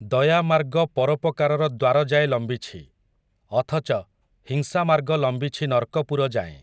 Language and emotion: Odia, neutral